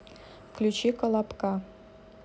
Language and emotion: Russian, neutral